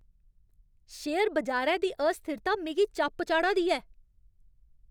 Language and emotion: Dogri, angry